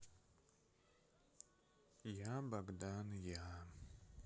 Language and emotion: Russian, sad